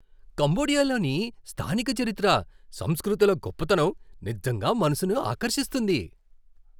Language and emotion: Telugu, surprised